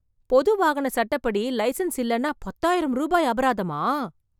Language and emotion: Tamil, surprised